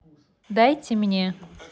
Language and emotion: Russian, neutral